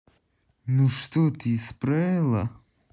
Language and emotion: Russian, angry